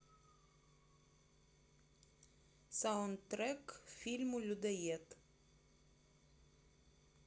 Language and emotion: Russian, neutral